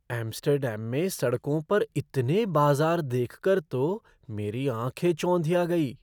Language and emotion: Hindi, surprised